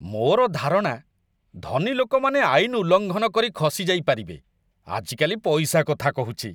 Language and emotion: Odia, disgusted